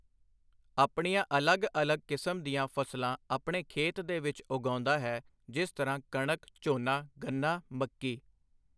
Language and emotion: Punjabi, neutral